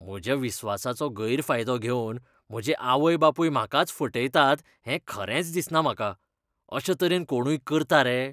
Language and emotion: Goan Konkani, disgusted